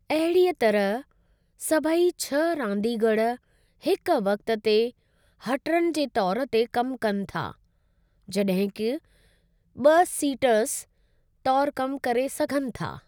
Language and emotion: Sindhi, neutral